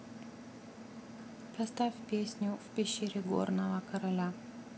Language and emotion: Russian, neutral